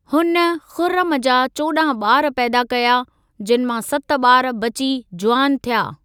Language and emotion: Sindhi, neutral